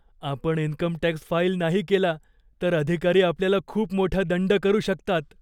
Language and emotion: Marathi, fearful